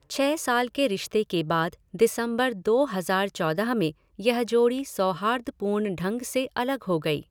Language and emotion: Hindi, neutral